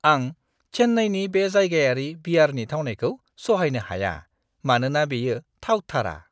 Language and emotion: Bodo, disgusted